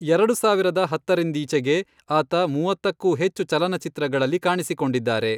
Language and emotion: Kannada, neutral